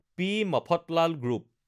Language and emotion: Assamese, neutral